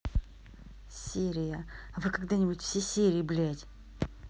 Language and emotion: Russian, angry